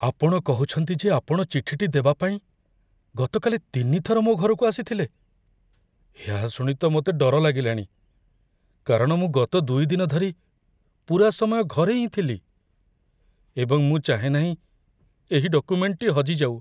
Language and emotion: Odia, fearful